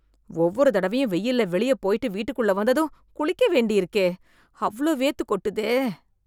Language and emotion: Tamil, disgusted